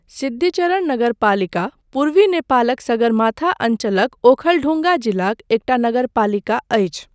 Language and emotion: Maithili, neutral